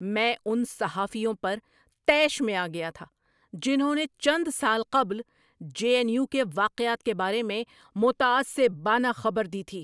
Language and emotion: Urdu, angry